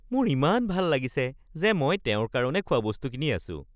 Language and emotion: Assamese, happy